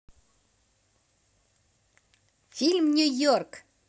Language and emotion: Russian, positive